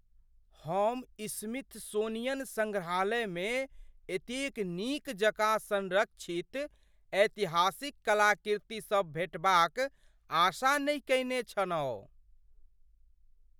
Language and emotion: Maithili, surprised